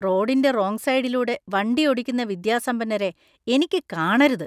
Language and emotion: Malayalam, disgusted